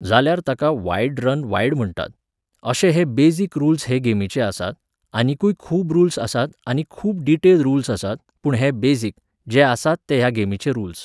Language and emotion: Goan Konkani, neutral